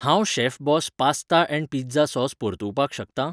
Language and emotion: Goan Konkani, neutral